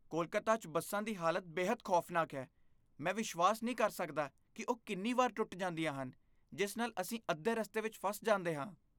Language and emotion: Punjabi, disgusted